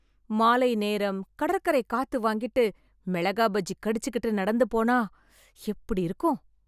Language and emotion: Tamil, happy